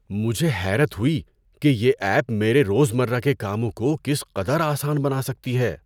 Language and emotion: Urdu, surprised